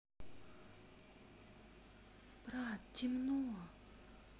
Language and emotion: Russian, neutral